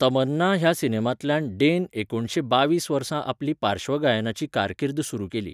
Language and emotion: Goan Konkani, neutral